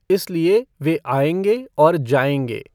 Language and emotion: Hindi, neutral